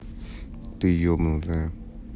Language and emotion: Russian, neutral